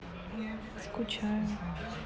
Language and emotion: Russian, sad